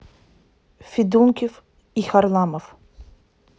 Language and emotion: Russian, neutral